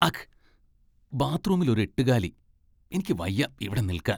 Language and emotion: Malayalam, disgusted